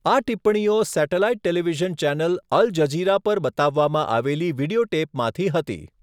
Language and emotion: Gujarati, neutral